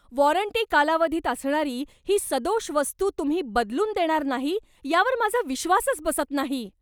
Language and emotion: Marathi, angry